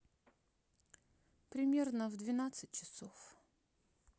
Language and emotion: Russian, neutral